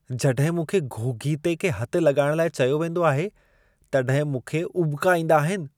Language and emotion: Sindhi, disgusted